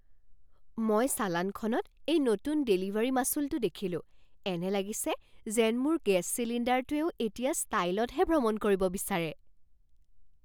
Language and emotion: Assamese, surprised